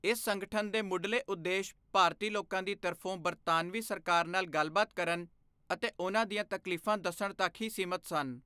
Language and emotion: Punjabi, neutral